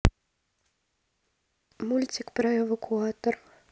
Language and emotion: Russian, neutral